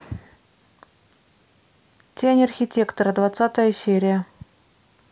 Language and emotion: Russian, neutral